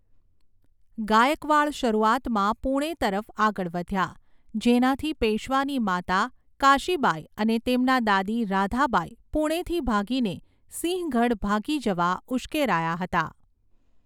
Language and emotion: Gujarati, neutral